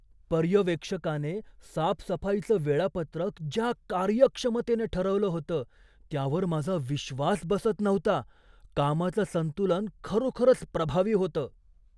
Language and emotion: Marathi, surprised